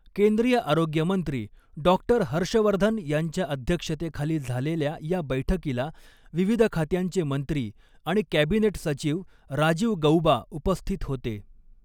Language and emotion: Marathi, neutral